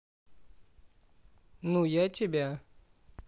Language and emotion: Russian, neutral